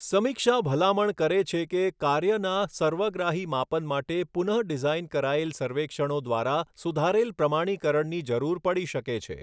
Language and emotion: Gujarati, neutral